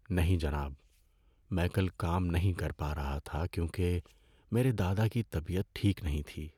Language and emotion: Urdu, sad